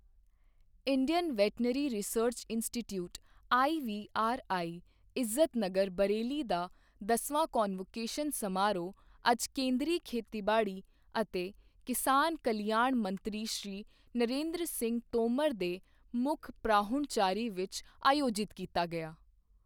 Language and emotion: Punjabi, neutral